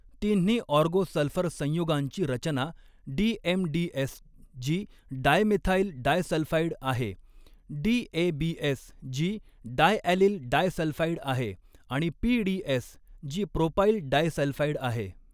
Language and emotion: Marathi, neutral